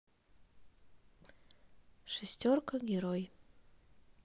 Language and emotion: Russian, neutral